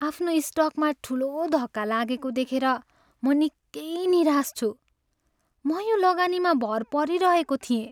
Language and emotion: Nepali, sad